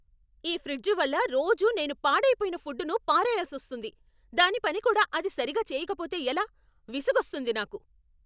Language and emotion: Telugu, angry